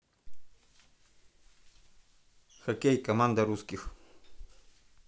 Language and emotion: Russian, neutral